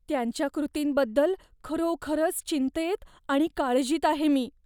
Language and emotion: Marathi, fearful